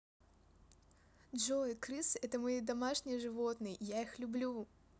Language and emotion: Russian, positive